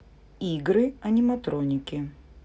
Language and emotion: Russian, neutral